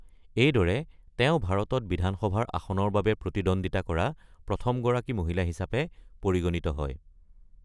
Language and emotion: Assamese, neutral